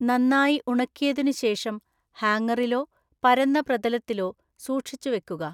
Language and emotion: Malayalam, neutral